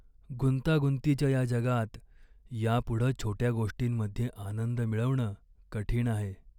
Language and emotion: Marathi, sad